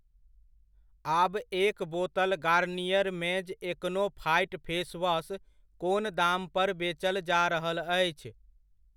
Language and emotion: Maithili, neutral